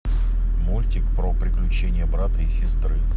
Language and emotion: Russian, neutral